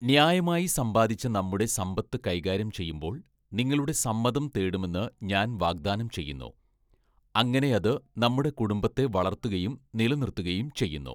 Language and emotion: Malayalam, neutral